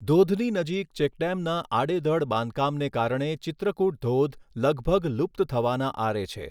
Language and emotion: Gujarati, neutral